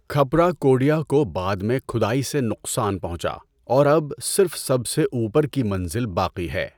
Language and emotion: Urdu, neutral